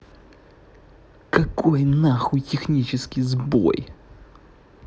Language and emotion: Russian, angry